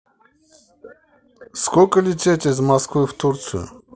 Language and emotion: Russian, neutral